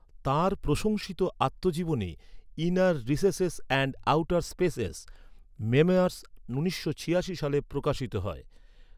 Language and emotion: Bengali, neutral